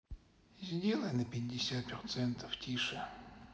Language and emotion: Russian, sad